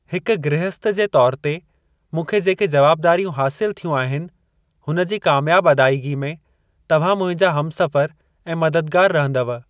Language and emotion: Sindhi, neutral